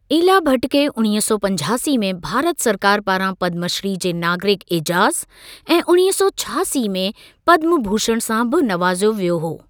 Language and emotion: Sindhi, neutral